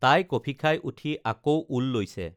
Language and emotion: Assamese, neutral